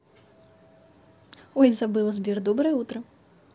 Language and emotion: Russian, positive